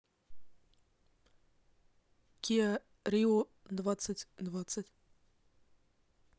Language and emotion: Russian, neutral